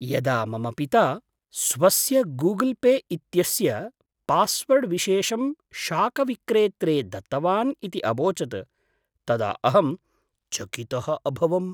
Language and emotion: Sanskrit, surprised